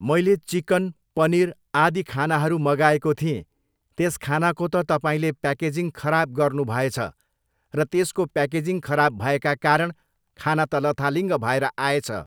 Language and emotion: Nepali, neutral